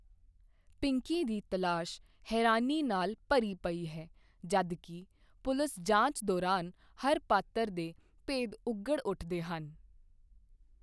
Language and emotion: Punjabi, neutral